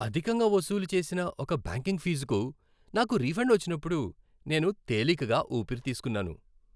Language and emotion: Telugu, happy